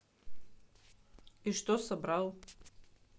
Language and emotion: Russian, neutral